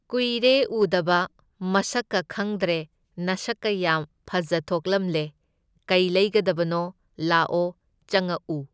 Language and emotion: Manipuri, neutral